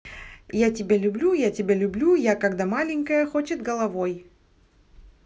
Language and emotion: Russian, positive